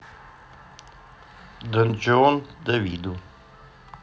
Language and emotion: Russian, neutral